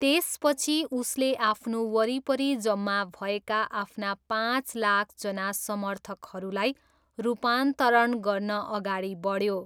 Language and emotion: Nepali, neutral